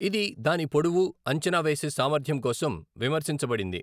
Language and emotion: Telugu, neutral